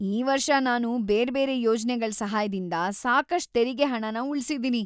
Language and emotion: Kannada, happy